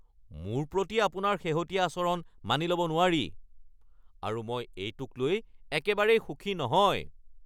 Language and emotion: Assamese, angry